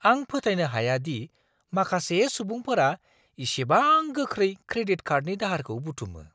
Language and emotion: Bodo, surprised